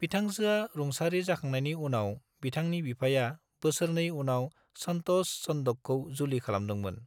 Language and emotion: Bodo, neutral